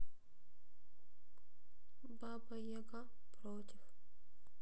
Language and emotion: Russian, sad